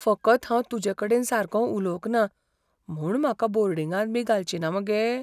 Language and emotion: Goan Konkani, fearful